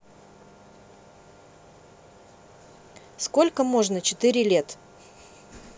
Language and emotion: Russian, neutral